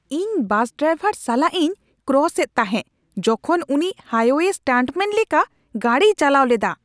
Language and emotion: Santali, angry